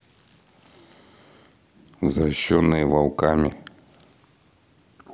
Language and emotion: Russian, neutral